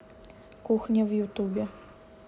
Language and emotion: Russian, neutral